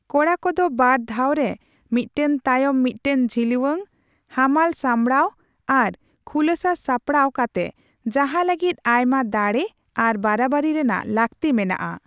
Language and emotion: Santali, neutral